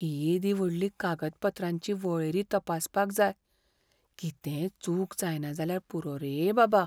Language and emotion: Goan Konkani, fearful